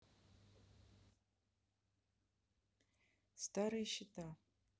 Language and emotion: Russian, neutral